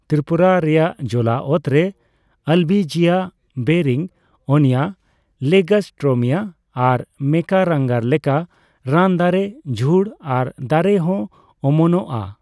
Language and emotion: Santali, neutral